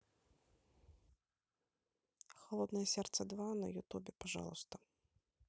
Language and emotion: Russian, neutral